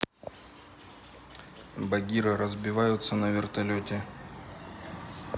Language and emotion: Russian, neutral